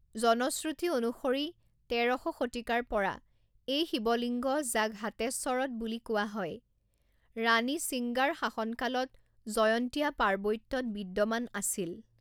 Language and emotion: Assamese, neutral